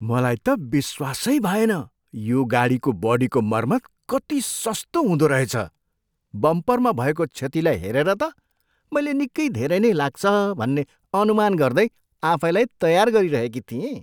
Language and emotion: Nepali, surprised